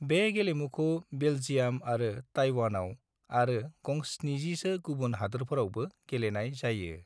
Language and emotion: Bodo, neutral